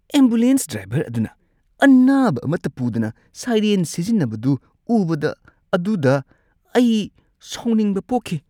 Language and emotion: Manipuri, disgusted